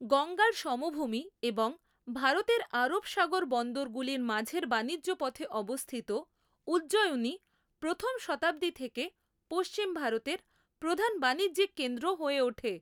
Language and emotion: Bengali, neutral